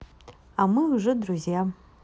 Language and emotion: Russian, positive